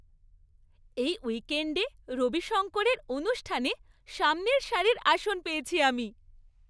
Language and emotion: Bengali, happy